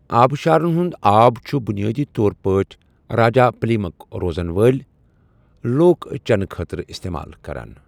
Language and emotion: Kashmiri, neutral